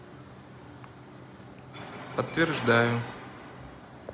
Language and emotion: Russian, neutral